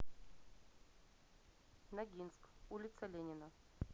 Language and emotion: Russian, neutral